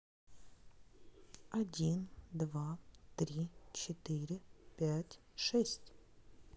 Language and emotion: Russian, neutral